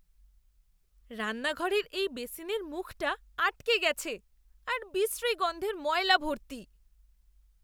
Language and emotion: Bengali, disgusted